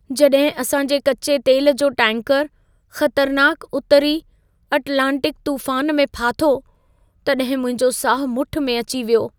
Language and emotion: Sindhi, fearful